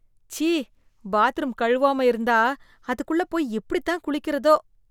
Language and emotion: Tamil, disgusted